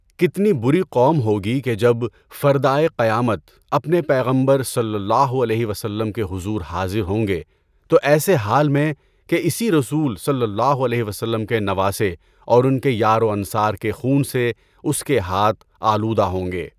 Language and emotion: Urdu, neutral